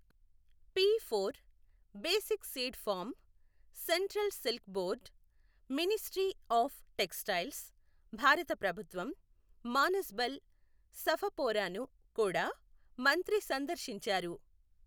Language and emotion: Telugu, neutral